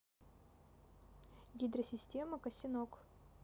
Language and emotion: Russian, neutral